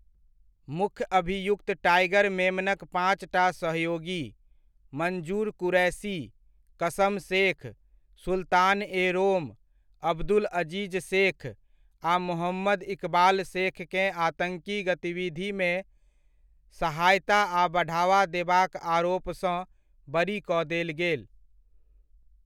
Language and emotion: Maithili, neutral